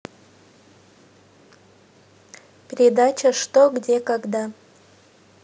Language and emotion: Russian, neutral